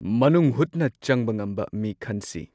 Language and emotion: Manipuri, neutral